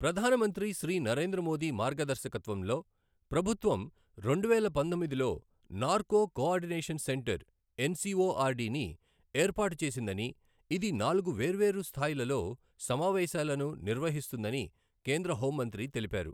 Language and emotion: Telugu, neutral